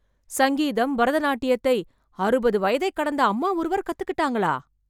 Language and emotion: Tamil, surprised